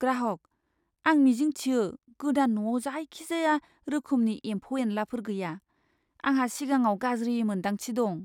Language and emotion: Bodo, fearful